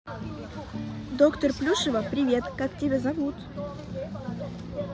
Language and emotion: Russian, positive